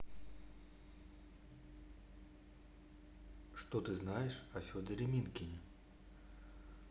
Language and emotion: Russian, neutral